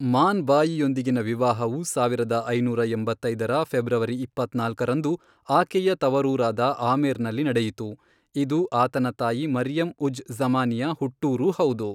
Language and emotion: Kannada, neutral